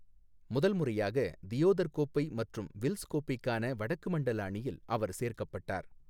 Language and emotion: Tamil, neutral